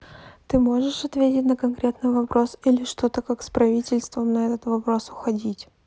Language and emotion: Russian, neutral